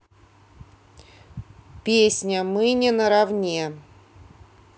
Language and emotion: Russian, neutral